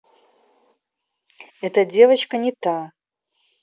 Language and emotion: Russian, neutral